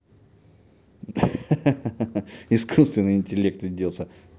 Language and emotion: Russian, positive